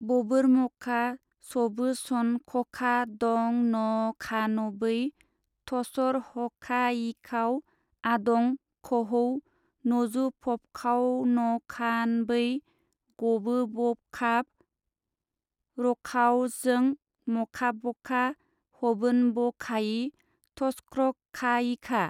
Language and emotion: Bodo, neutral